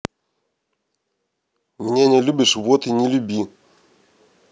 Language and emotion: Russian, neutral